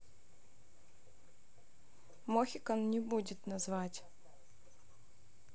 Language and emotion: Russian, neutral